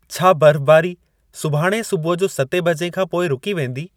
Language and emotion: Sindhi, neutral